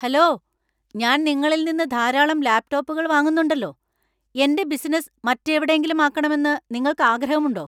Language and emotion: Malayalam, angry